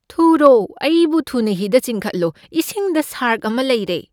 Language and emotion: Manipuri, fearful